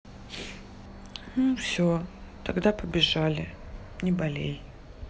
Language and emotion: Russian, sad